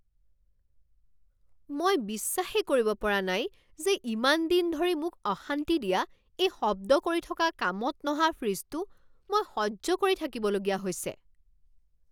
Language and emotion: Assamese, angry